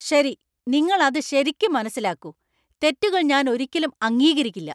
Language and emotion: Malayalam, angry